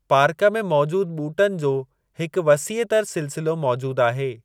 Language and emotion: Sindhi, neutral